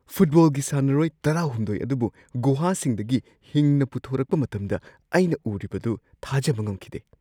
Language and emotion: Manipuri, surprised